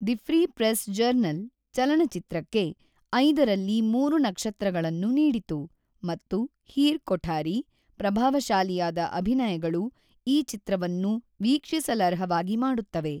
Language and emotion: Kannada, neutral